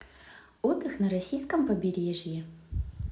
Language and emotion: Russian, positive